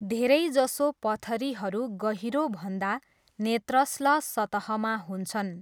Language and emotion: Nepali, neutral